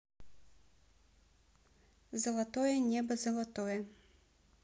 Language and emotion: Russian, neutral